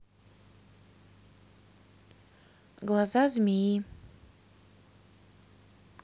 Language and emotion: Russian, neutral